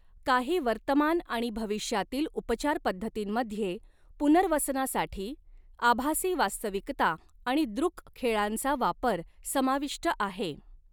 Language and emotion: Marathi, neutral